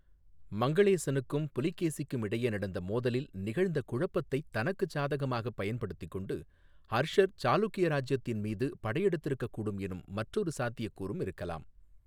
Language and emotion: Tamil, neutral